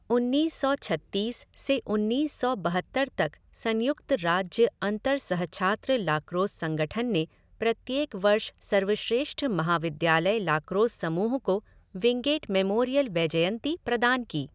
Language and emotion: Hindi, neutral